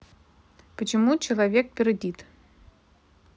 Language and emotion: Russian, neutral